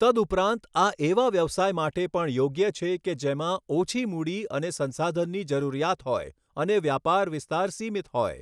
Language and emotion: Gujarati, neutral